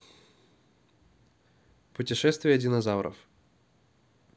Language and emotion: Russian, neutral